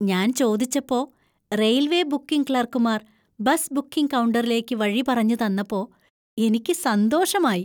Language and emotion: Malayalam, happy